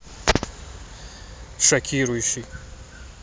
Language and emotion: Russian, neutral